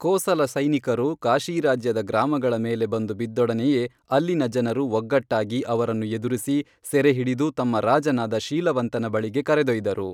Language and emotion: Kannada, neutral